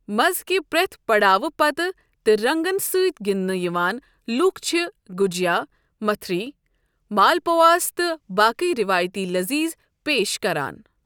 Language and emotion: Kashmiri, neutral